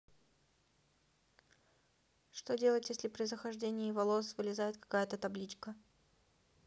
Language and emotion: Russian, neutral